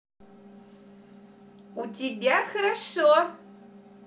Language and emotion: Russian, positive